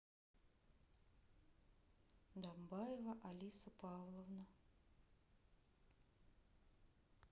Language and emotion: Russian, neutral